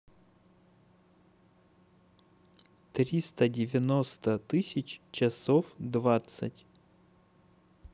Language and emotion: Russian, neutral